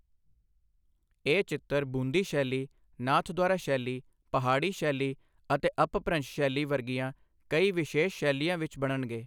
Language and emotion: Punjabi, neutral